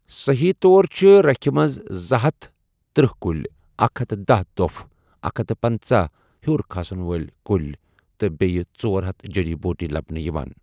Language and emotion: Kashmiri, neutral